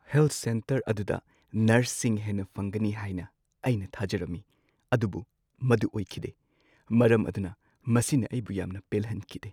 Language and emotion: Manipuri, sad